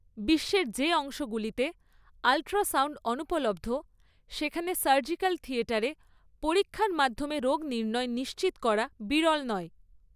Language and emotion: Bengali, neutral